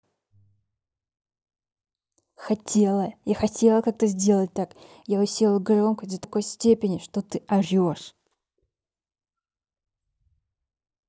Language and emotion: Russian, angry